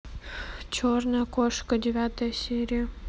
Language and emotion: Russian, neutral